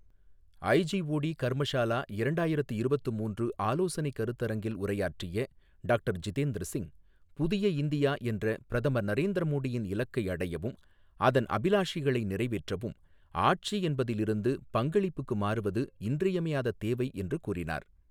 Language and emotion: Tamil, neutral